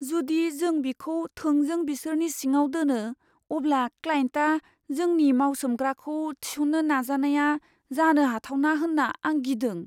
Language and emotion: Bodo, fearful